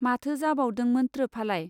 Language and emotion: Bodo, neutral